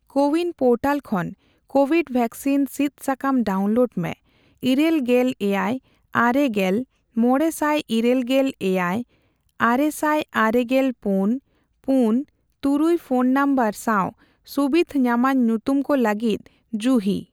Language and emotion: Santali, neutral